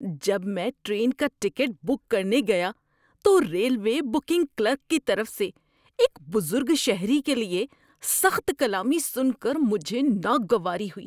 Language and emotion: Urdu, disgusted